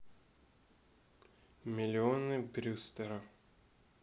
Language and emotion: Russian, neutral